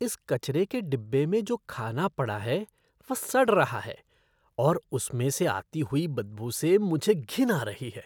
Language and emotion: Hindi, disgusted